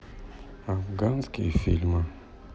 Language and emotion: Russian, neutral